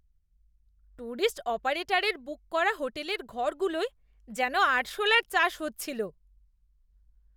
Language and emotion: Bengali, disgusted